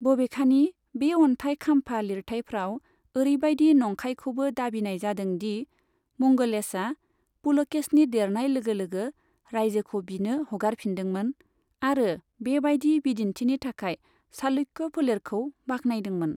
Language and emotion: Bodo, neutral